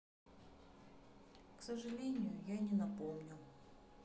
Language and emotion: Russian, sad